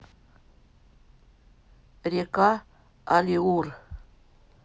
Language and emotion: Russian, neutral